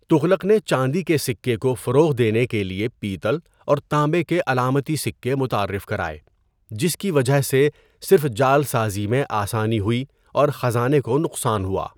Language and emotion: Urdu, neutral